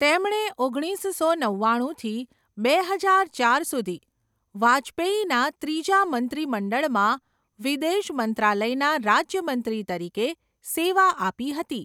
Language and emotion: Gujarati, neutral